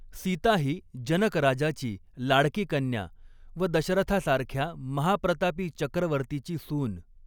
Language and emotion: Marathi, neutral